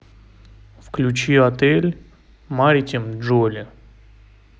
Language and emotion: Russian, neutral